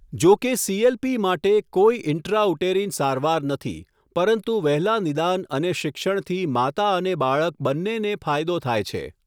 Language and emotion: Gujarati, neutral